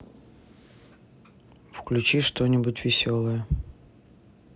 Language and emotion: Russian, neutral